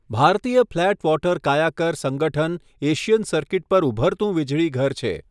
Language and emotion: Gujarati, neutral